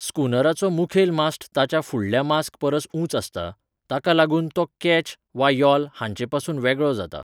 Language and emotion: Goan Konkani, neutral